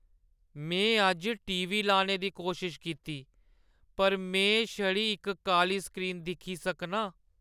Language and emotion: Dogri, sad